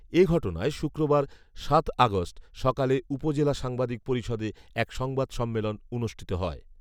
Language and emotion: Bengali, neutral